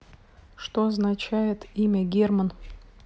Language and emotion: Russian, neutral